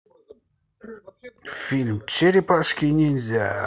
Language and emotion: Russian, positive